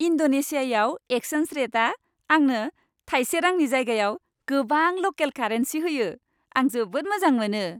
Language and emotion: Bodo, happy